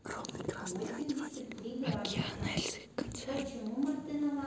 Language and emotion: Russian, neutral